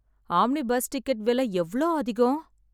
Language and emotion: Tamil, sad